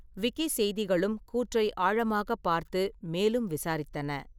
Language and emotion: Tamil, neutral